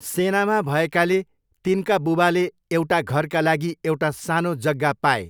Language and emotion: Nepali, neutral